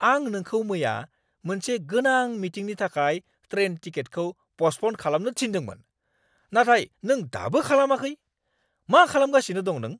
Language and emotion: Bodo, angry